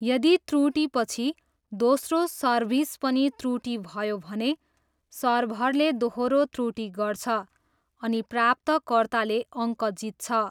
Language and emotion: Nepali, neutral